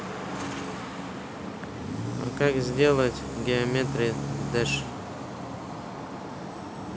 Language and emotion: Russian, neutral